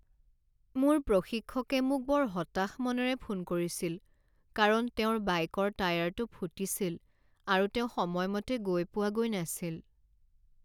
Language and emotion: Assamese, sad